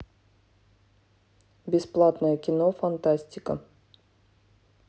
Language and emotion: Russian, neutral